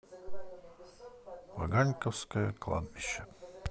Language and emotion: Russian, neutral